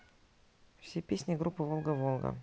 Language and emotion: Russian, neutral